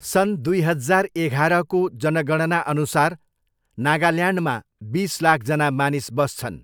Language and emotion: Nepali, neutral